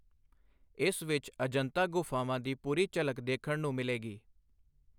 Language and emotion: Punjabi, neutral